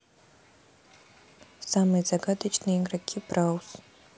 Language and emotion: Russian, neutral